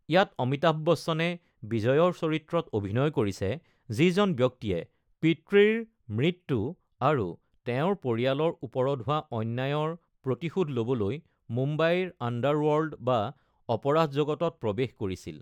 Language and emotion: Assamese, neutral